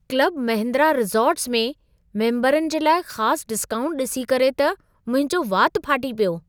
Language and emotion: Sindhi, surprised